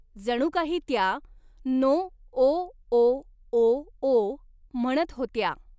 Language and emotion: Marathi, neutral